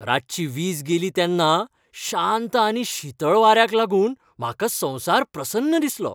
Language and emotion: Goan Konkani, happy